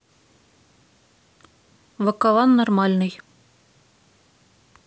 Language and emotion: Russian, neutral